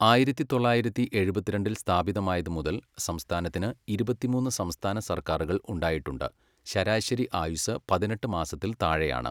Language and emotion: Malayalam, neutral